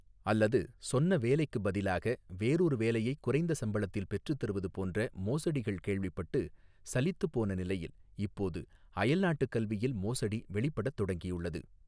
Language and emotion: Tamil, neutral